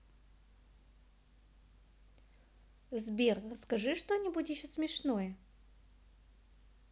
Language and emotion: Russian, positive